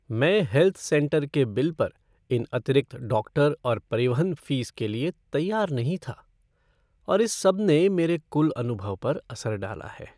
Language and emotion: Hindi, sad